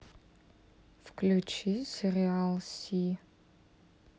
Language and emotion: Russian, neutral